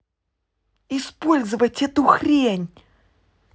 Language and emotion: Russian, angry